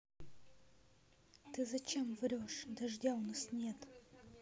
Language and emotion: Russian, neutral